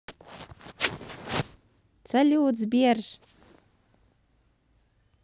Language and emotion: Russian, positive